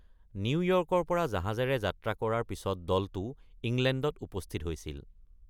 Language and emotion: Assamese, neutral